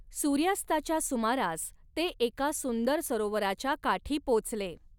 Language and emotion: Marathi, neutral